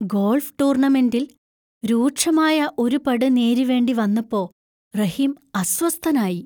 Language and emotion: Malayalam, fearful